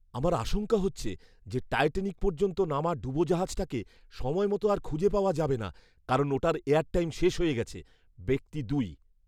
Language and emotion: Bengali, fearful